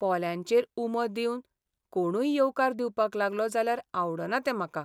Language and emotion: Goan Konkani, sad